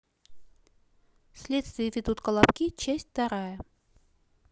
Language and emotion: Russian, neutral